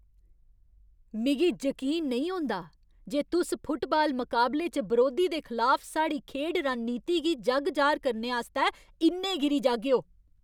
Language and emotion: Dogri, angry